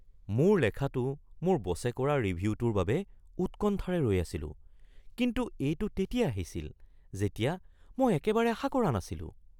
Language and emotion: Assamese, surprised